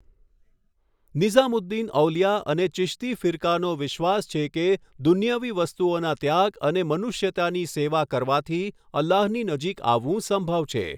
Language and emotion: Gujarati, neutral